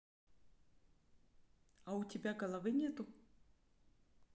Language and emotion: Russian, neutral